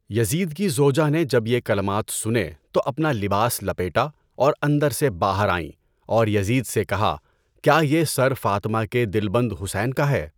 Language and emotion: Urdu, neutral